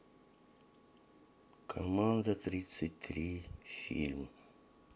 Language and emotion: Russian, sad